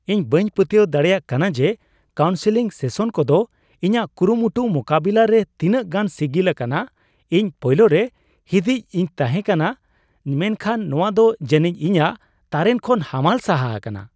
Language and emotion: Santali, surprised